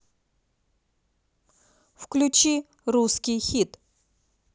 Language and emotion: Russian, neutral